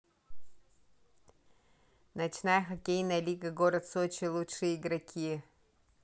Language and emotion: Russian, neutral